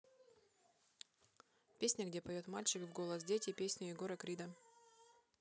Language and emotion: Russian, neutral